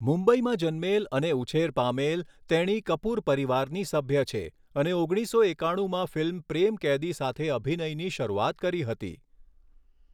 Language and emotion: Gujarati, neutral